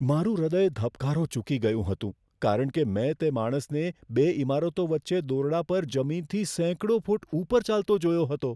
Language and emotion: Gujarati, fearful